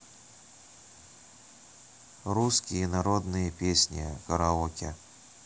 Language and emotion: Russian, neutral